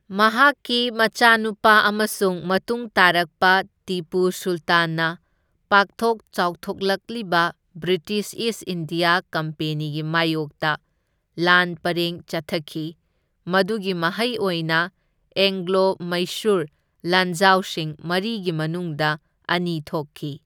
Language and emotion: Manipuri, neutral